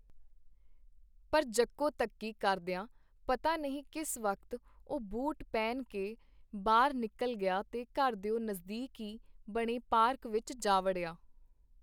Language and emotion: Punjabi, neutral